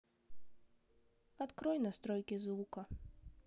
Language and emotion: Russian, sad